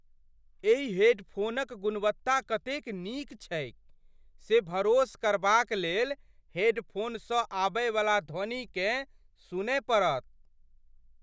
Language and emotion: Maithili, surprised